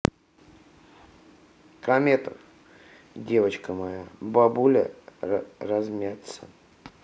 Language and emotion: Russian, neutral